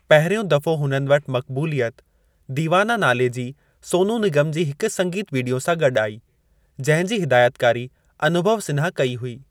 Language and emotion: Sindhi, neutral